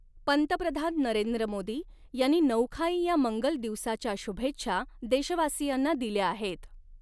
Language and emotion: Marathi, neutral